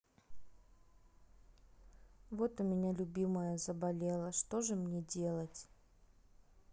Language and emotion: Russian, sad